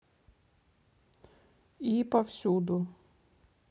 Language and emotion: Russian, neutral